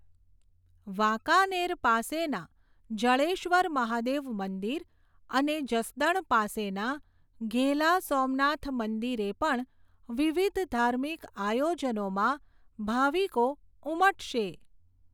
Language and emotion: Gujarati, neutral